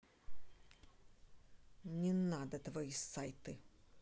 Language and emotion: Russian, angry